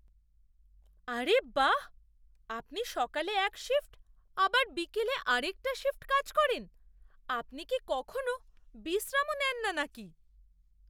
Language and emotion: Bengali, surprised